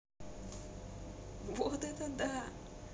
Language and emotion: Russian, positive